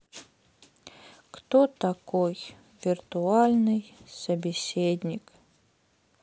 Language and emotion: Russian, sad